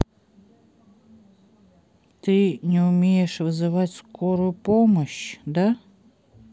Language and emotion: Russian, neutral